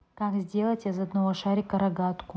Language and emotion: Russian, neutral